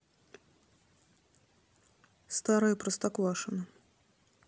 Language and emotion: Russian, neutral